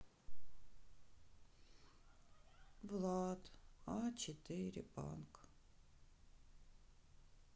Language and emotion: Russian, sad